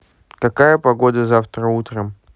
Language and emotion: Russian, neutral